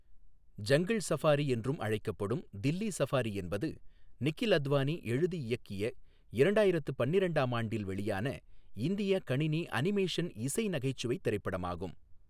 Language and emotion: Tamil, neutral